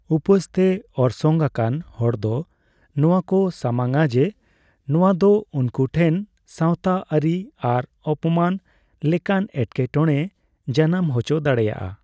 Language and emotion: Santali, neutral